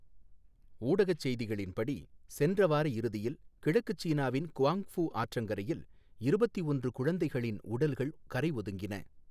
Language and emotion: Tamil, neutral